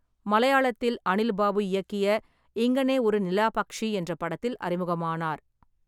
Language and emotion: Tamil, neutral